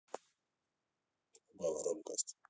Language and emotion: Russian, neutral